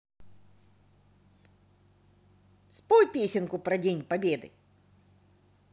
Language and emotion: Russian, positive